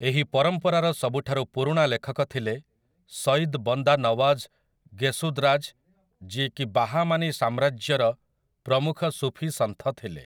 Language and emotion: Odia, neutral